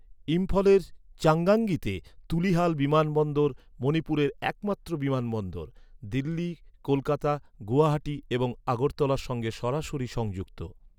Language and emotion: Bengali, neutral